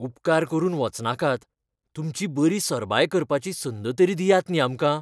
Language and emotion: Goan Konkani, fearful